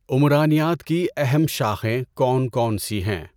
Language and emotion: Urdu, neutral